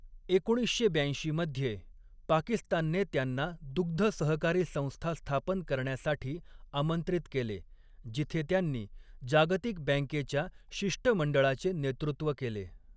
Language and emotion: Marathi, neutral